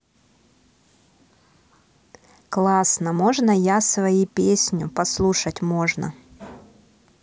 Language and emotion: Russian, positive